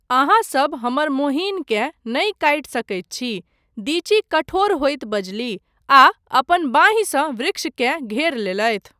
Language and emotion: Maithili, neutral